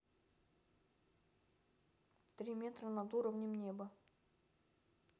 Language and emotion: Russian, neutral